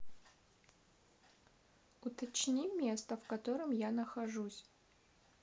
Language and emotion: Russian, neutral